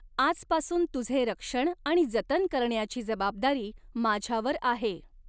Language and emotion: Marathi, neutral